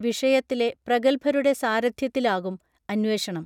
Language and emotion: Malayalam, neutral